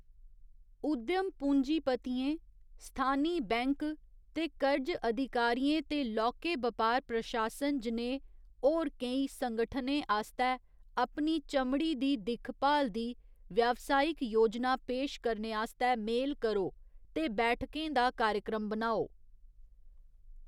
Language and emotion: Dogri, neutral